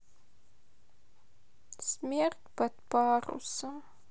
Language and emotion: Russian, sad